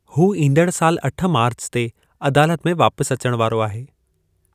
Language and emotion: Sindhi, neutral